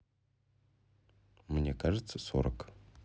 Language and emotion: Russian, neutral